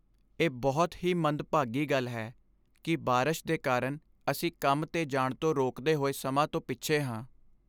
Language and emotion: Punjabi, sad